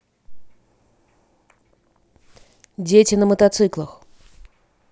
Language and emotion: Russian, neutral